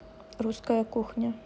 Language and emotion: Russian, neutral